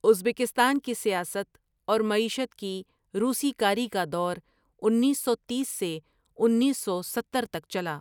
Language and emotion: Urdu, neutral